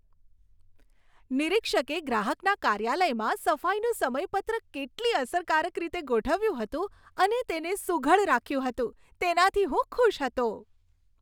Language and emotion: Gujarati, happy